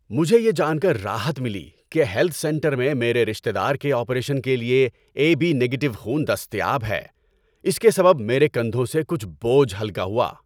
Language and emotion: Urdu, happy